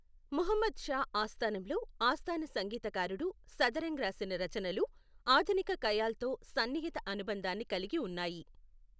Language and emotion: Telugu, neutral